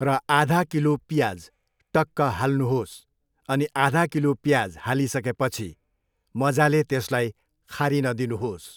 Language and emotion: Nepali, neutral